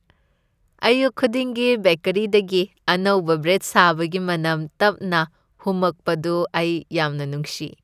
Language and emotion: Manipuri, happy